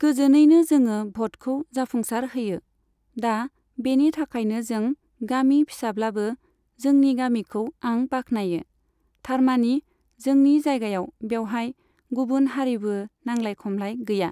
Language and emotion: Bodo, neutral